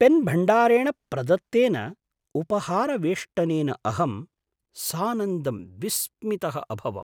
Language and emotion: Sanskrit, surprised